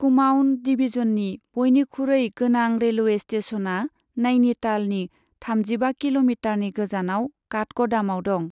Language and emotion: Bodo, neutral